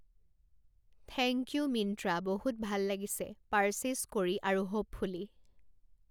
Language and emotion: Assamese, neutral